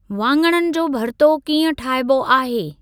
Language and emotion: Sindhi, neutral